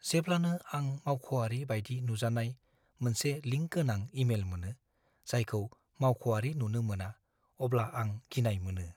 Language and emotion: Bodo, fearful